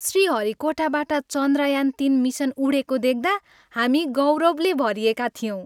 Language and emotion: Nepali, happy